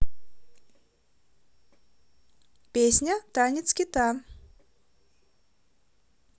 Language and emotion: Russian, positive